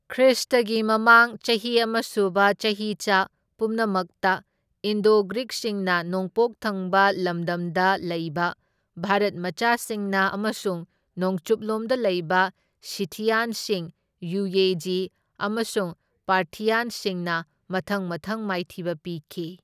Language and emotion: Manipuri, neutral